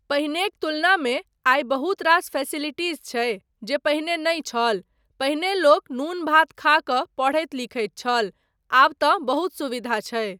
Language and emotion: Maithili, neutral